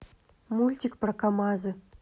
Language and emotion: Russian, neutral